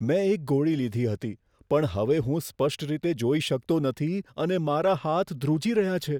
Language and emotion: Gujarati, fearful